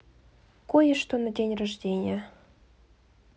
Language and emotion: Russian, neutral